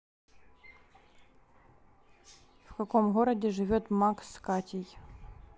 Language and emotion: Russian, neutral